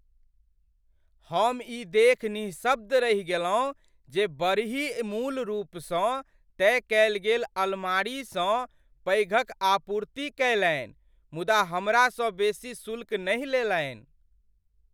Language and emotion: Maithili, surprised